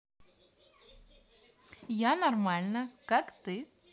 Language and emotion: Russian, positive